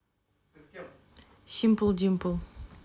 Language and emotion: Russian, neutral